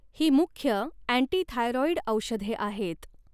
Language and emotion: Marathi, neutral